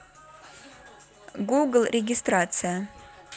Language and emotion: Russian, neutral